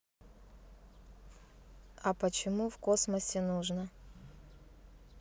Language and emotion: Russian, neutral